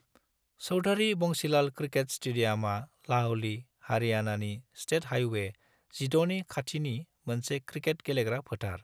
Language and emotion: Bodo, neutral